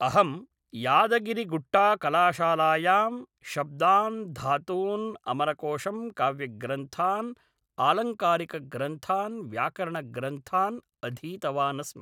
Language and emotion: Sanskrit, neutral